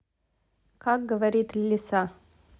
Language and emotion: Russian, neutral